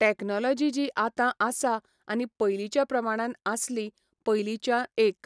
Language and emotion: Goan Konkani, neutral